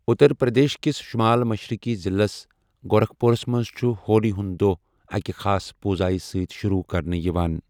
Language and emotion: Kashmiri, neutral